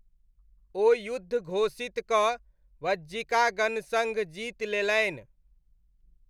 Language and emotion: Maithili, neutral